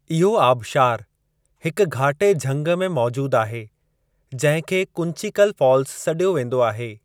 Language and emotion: Sindhi, neutral